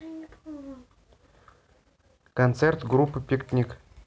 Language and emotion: Russian, neutral